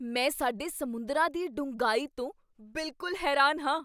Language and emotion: Punjabi, surprised